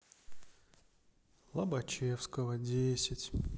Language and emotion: Russian, sad